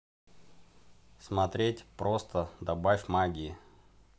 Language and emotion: Russian, neutral